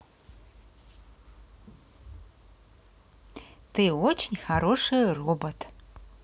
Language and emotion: Russian, positive